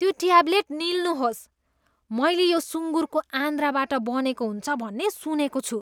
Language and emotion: Nepali, disgusted